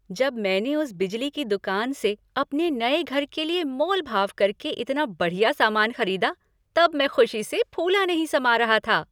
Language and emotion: Hindi, happy